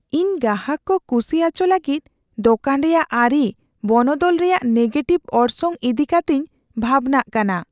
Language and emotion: Santali, fearful